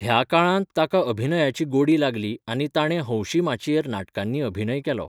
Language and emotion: Goan Konkani, neutral